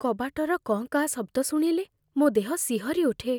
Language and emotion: Odia, fearful